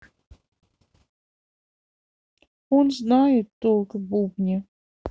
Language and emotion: Russian, sad